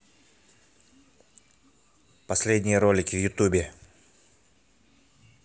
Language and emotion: Russian, neutral